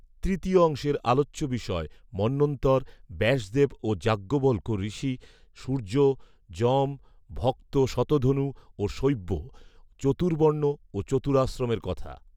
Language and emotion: Bengali, neutral